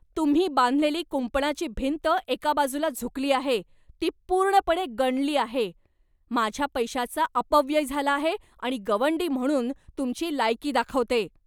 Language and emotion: Marathi, angry